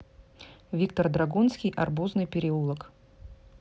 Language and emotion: Russian, neutral